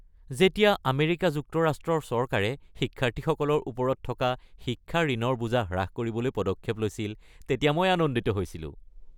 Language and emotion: Assamese, happy